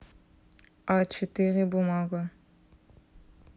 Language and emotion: Russian, neutral